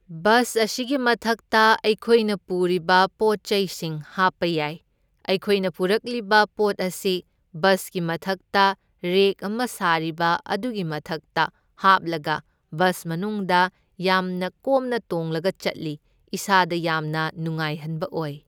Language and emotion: Manipuri, neutral